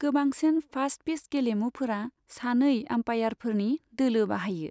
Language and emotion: Bodo, neutral